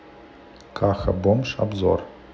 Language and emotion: Russian, neutral